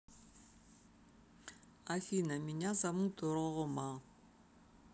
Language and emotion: Russian, neutral